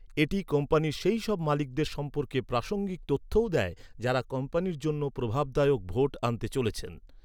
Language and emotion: Bengali, neutral